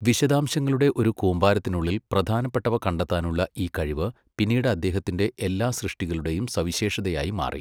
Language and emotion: Malayalam, neutral